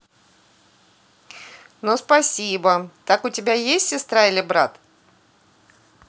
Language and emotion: Russian, positive